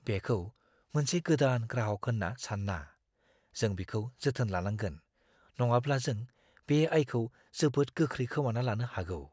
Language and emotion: Bodo, fearful